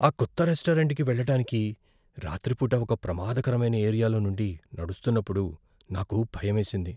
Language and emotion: Telugu, fearful